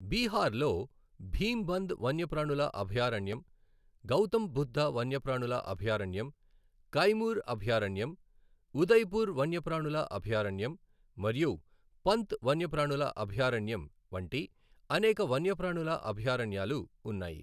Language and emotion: Telugu, neutral